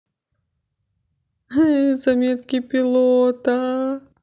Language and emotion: Russian, positive